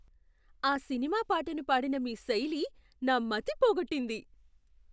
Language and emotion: Telugu, surprised